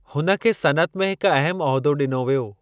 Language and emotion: Sindhi, neutral